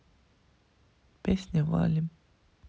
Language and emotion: Russian, neutral